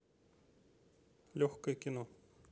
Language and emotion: Russian, neutral